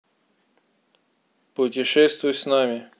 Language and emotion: Russian, neutral